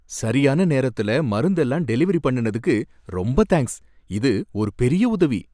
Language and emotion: Tamil, happy